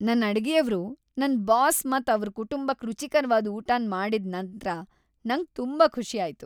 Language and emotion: Kannada, happy